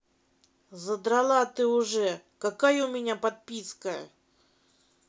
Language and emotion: Russian, angry